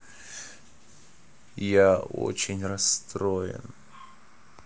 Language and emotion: Russian, sad